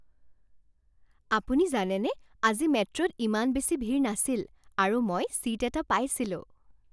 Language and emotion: Assamese, happy